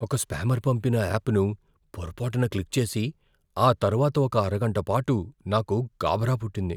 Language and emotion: Telugu, fearful